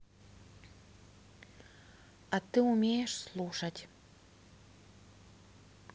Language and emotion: Russian, neutral